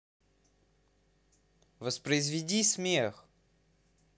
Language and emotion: Russian, neutral